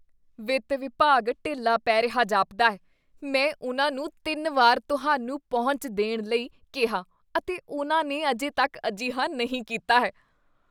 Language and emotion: Punjabi, disgusted